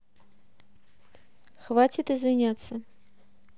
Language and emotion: Russian, neutral